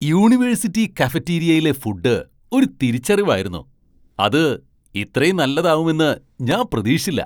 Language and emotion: Malayalam, surprised